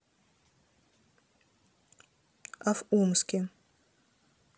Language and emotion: Russian, neutral